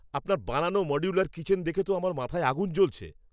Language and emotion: Bengali, angry